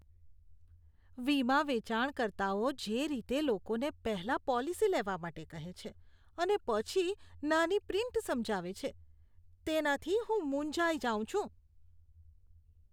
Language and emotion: Gujarati, disgusted